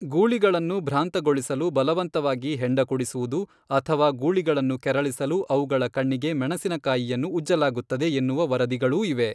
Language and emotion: Kannada, neutral